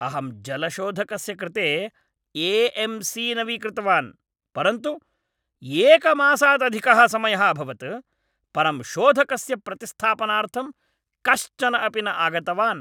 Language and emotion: Sanskrit, angry